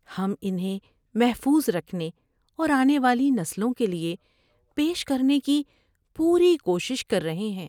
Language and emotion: Urdu, sad